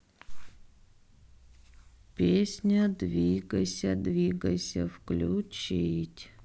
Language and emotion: Russian, sad